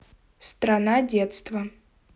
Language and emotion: Russian, neutral